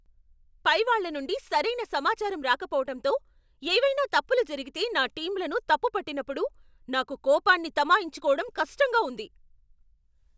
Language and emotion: Telugu, angry